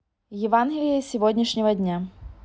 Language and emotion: Russian, neutral